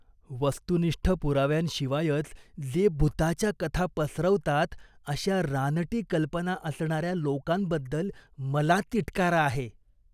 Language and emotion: Marathi, disgusted